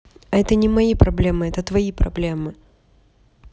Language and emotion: Russian, neutral